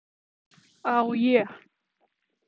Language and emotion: Russian, neutral